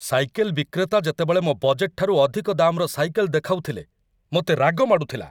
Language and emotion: Odia, angry